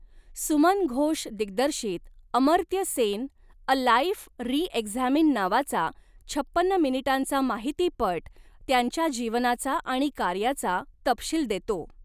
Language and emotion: Marathi, neutral